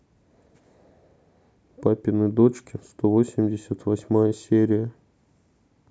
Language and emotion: Russian, sad